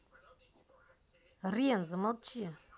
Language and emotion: Russian, angry